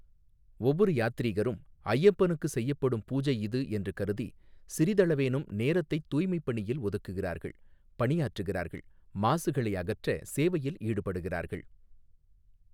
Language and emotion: Tamil, neutral